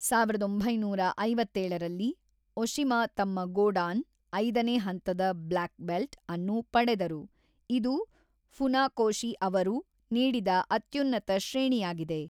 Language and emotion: Kannada, neutral